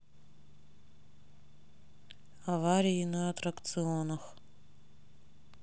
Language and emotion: Russian, neutral